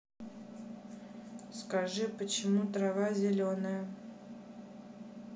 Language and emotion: Russian, neutral